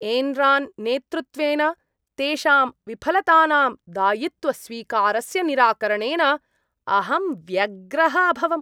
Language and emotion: Sanskrit, disgusted